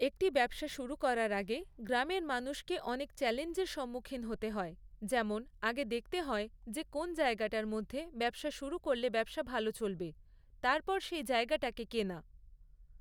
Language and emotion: Bengali, neutral